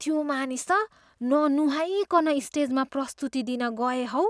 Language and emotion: Nepali, disgusted